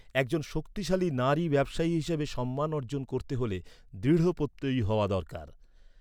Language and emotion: Bengali, neutral